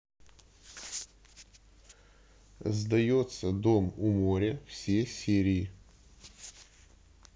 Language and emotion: Russian, neutral